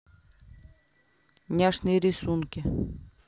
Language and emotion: Russian, neutral